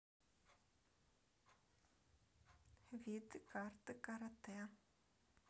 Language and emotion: Russian, neutral